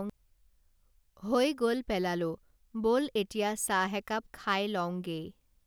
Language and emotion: Assamese, neutral